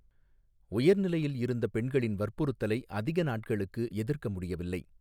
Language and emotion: Tamil, neutral